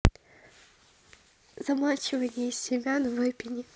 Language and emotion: Russian, neutral